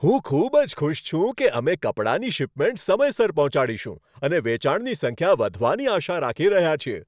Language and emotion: Gujarati, happy